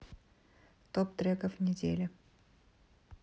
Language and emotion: Russian, neutral